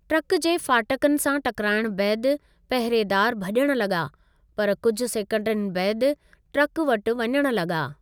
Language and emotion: Sindhi, neutral